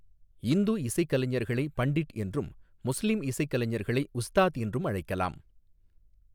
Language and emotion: Tamil, neutral